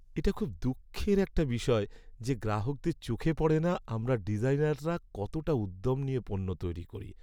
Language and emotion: Bengali, sad